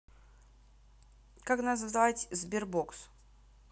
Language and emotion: Russian, neutral